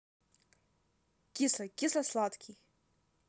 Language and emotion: Russian, neutral